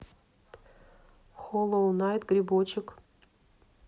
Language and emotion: Russian, neutral